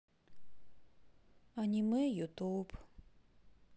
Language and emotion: Russian, sad